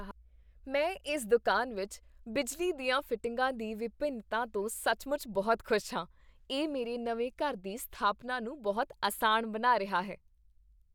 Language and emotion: Punjabi, happy